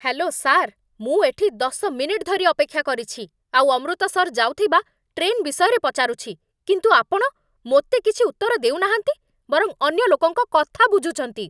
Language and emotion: Odia, angry